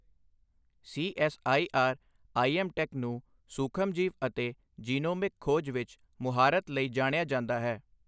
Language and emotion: Punjabi, neutral